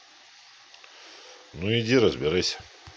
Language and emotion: Russian, neutral